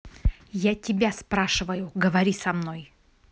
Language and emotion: Russian, angry